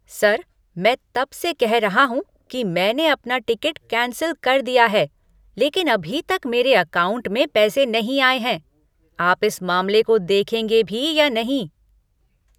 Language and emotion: Hindi, angry